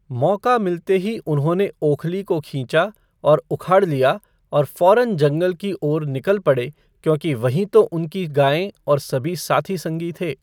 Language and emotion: Hindi, neutral